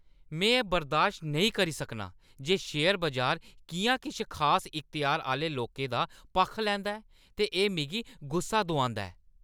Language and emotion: Dogri, angry